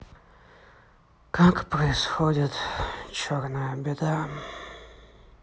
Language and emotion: Russian, sad